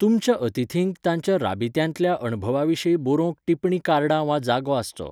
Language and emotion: Goan Konkani, neutral